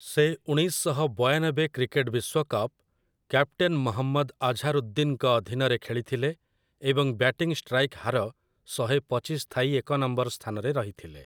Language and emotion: Odia, neutral